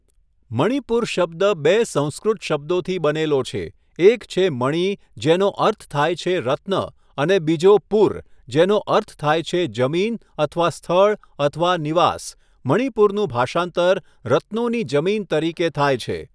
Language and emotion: Gujarati, neutral